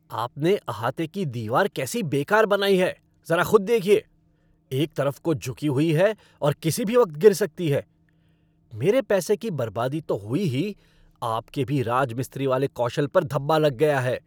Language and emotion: Hindi, angry